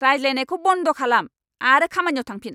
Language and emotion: Bodo, angry